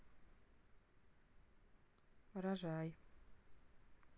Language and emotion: Russian, neutral